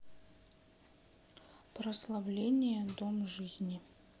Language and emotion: Russian, neutral